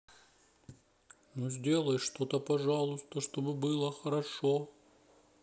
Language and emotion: Russian, sad